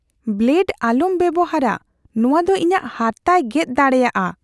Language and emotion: Santali, fearful